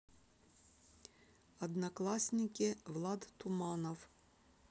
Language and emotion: Russian, neutral